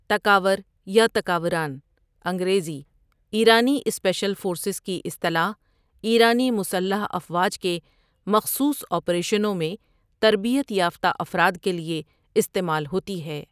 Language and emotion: Urdu, neutral